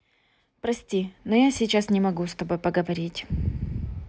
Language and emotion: Russian, neutral